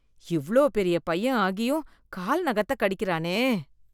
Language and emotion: Tamil, disgusted